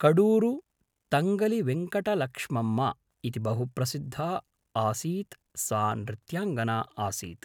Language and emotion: Sanskrit, neutral